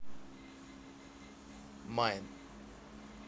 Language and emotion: Russian, neutral